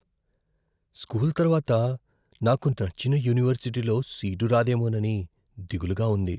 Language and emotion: Telugu, fearful